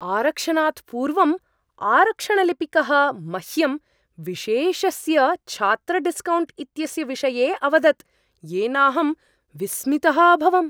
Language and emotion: Sanskrit, surprised